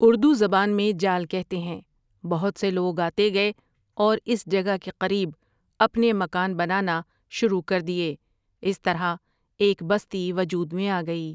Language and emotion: Urdu, neutral